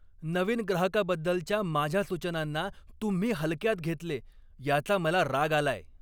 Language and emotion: Marathi, angry